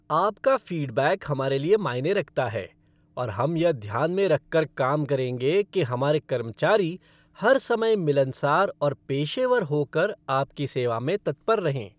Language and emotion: Hindi, happy